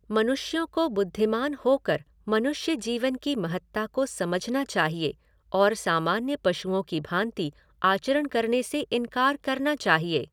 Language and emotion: Hindi, neutral